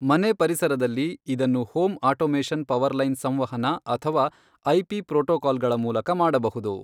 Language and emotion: Kannada, neutral